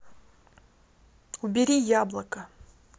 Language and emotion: Russian, neutral